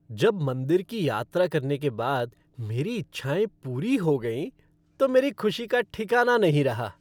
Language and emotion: Hindi, happy